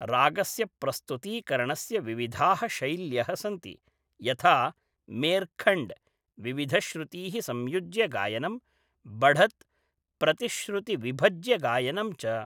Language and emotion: Sanskrit, neutral